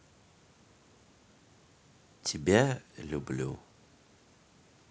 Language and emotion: Russian, neutral